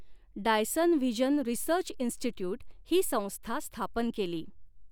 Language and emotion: Marathi, neutral